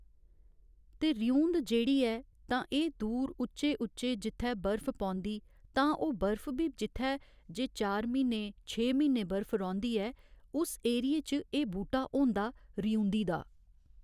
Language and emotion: Dogri, neutral